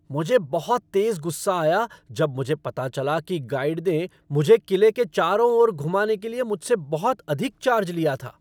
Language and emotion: Hindi, angry